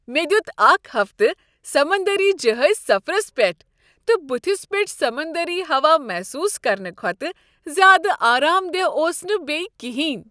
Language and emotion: Kashmiri, happy